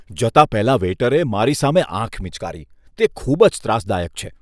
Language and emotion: Gujarati, disgusted